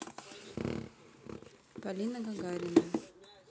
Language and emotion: Russian, neutral